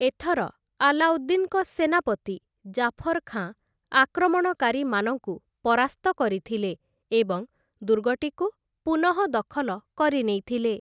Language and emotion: Odia, neutral